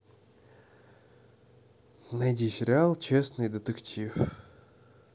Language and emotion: Russian, neutral